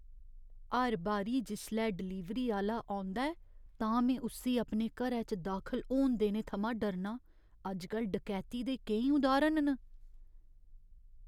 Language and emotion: Dogri, fearful